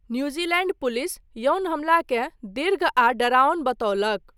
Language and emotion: Maithili, neutral